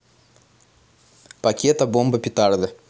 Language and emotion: Russian, neutral